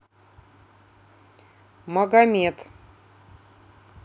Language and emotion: Russian, neutral